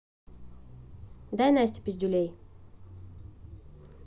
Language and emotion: Russian, neutral